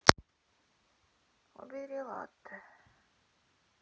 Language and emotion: Russian, sad